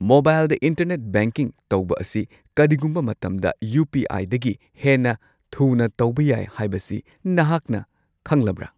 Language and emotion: Manipuri, surprised